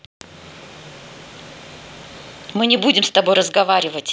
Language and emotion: Russian, angry